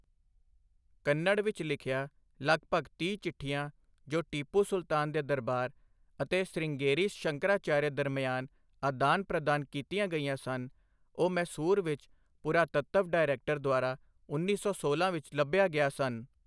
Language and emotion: Punjabi, neutral